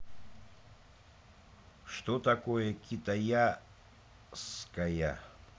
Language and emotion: Russian, neutral